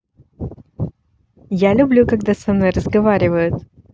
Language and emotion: Russian, positive